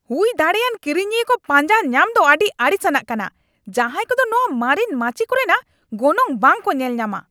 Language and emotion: Santali, angry